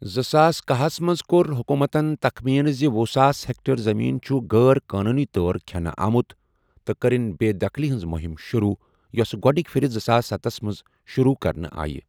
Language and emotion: Kashmiri, neutral